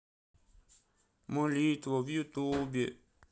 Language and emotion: Russian, sad